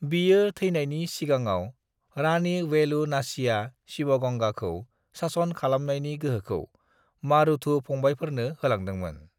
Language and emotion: Bodo, neutral